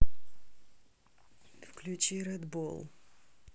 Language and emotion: Russian, neutral